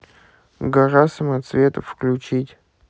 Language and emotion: Russian, neutral